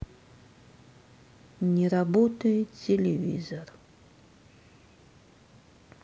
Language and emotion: Russian, sad